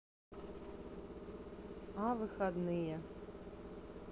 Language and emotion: Russian, neutral